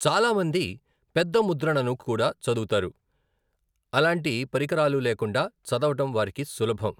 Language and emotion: Telugu, neutral